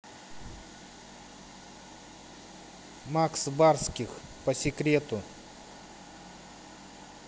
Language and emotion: Russian, neutral